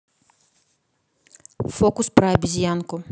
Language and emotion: Russian, neutral